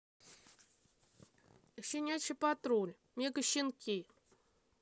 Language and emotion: Russian, neutral